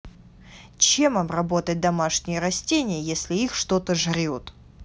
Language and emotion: Russian, angry